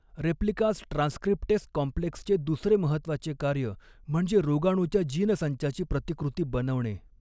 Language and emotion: Marathi, neutral